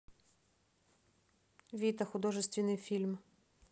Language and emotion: Russian, neutral